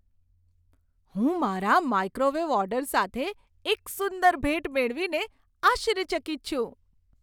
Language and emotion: Gujarati, surprised